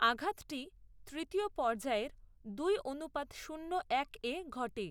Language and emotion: Bengali, neutral